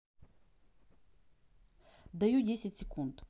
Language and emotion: Russian, neutral